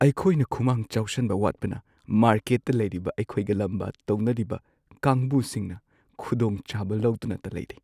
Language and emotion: Manipuri, sad